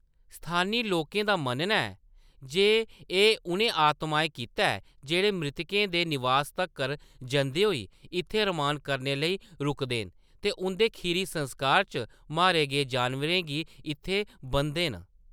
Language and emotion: Dogri, neutral